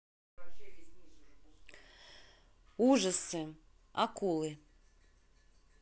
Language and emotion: Russian, neutral